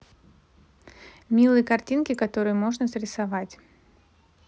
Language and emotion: Russian, neutral